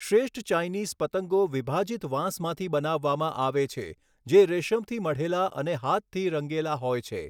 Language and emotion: Gujarati, neutral